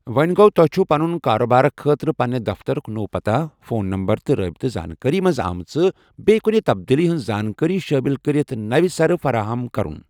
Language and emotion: Kashmiri, neutral